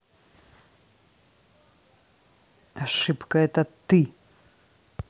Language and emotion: Russian, angry